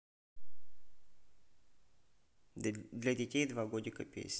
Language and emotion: Russian, neutral